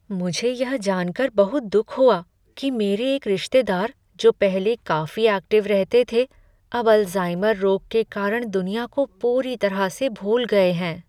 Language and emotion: Hindi, sad